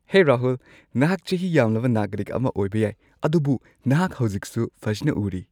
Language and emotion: Manipuri, happy